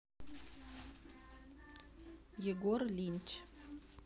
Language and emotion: Russian, neutral